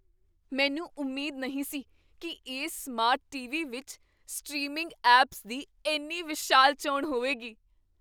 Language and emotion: Punjabi, surprised